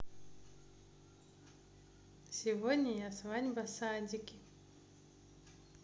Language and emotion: Russian, neutral